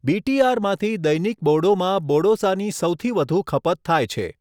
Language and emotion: Gujarati, neutral